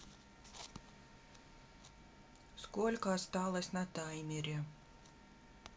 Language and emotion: Russian, neutral